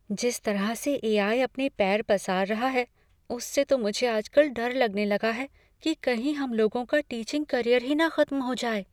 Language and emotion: Hindi, fearful